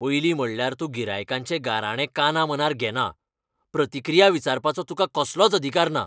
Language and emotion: Goan Konkani, angry